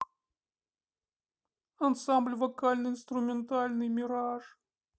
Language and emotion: Russian, sad